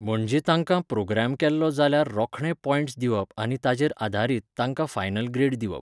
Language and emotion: Goan Konkani, neutral